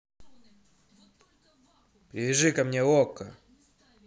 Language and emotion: Russian, angry